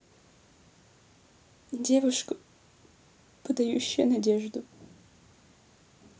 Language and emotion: Russian, sad